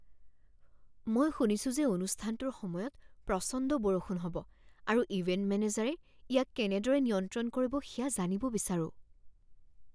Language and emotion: Assamese, fearful